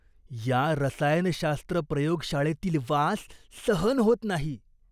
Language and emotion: Marathi, disgusted